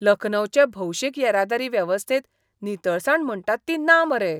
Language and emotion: Goan Konkani, disgusted